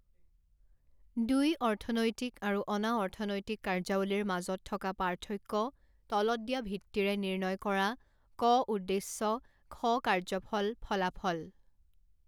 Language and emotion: Assamese, neutral